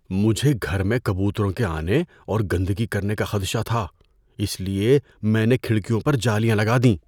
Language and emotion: Urdu, fearful